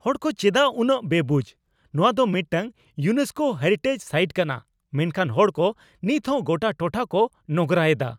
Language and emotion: Santali, angry